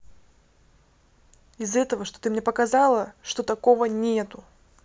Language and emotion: Russian, angry